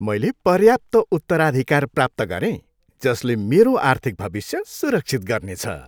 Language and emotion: Nepali, happy